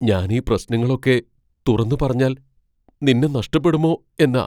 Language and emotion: Malayalam, fearful